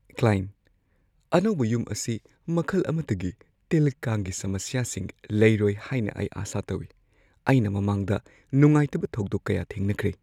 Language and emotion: Manipuri, fearful